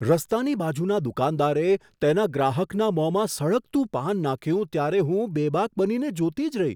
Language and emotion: Gujarati, surprised